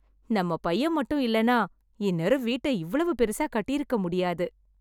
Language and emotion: Tamil, happy